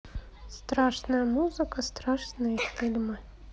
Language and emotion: Russian, neutral